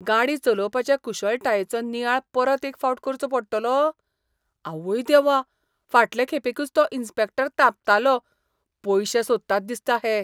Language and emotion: Goan Konkani, disgusted